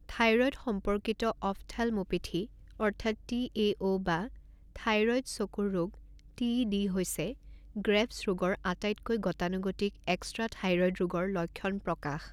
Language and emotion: Assamese, neutral